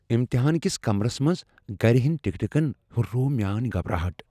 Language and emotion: Kashmiri, fearful